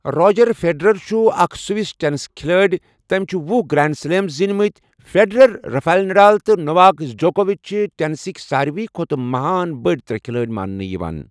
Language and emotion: Kashmiri, neutral